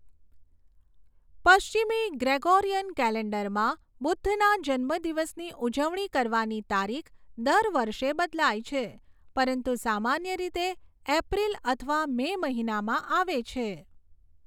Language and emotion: Gujarati, neutral